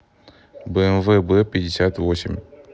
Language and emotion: Russian, neutral